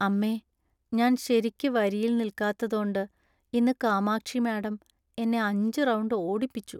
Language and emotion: Malayalam, sad